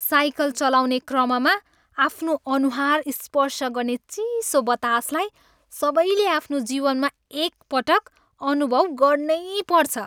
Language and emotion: Nepali, happy